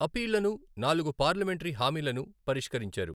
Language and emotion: Telugu, neutral